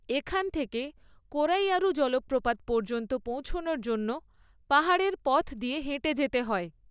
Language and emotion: Bengali, neutral